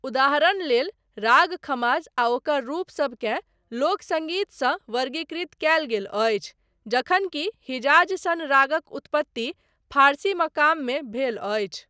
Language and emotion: Maithili, neutral